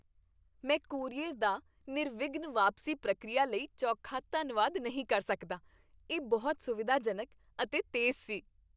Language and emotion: Punjabi, happy